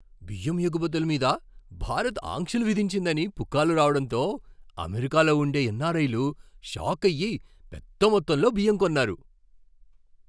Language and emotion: Telugu, surprised